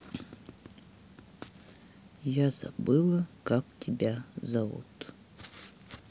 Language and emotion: Russian, sad